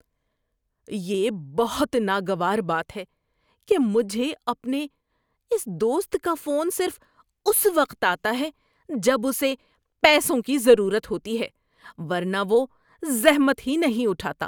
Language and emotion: Urdu, disgusted